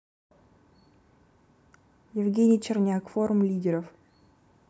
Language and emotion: Russian, neutral